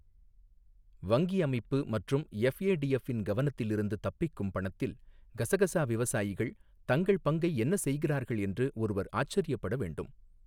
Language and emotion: Tamil, neutral